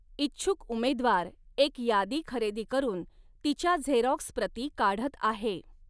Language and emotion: Marathi, neutral